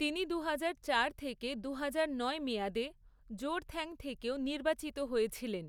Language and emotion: Bengali, neutral